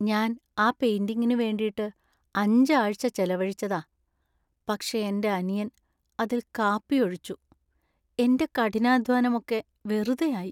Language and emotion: Malayalam, sad